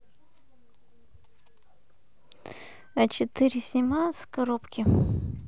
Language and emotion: Russian, neutral